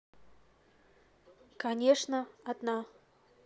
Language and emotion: Russian, neutral